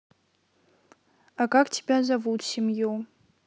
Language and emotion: Russian, neutral